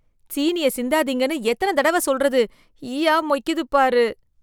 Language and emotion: Tamil, disgusted